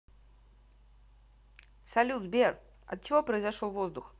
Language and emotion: Russian, positive